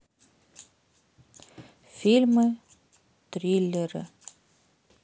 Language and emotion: Russian, sad